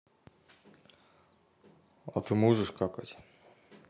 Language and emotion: Russian, neutral